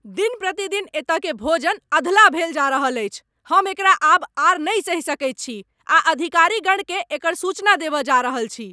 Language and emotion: Maithili, angry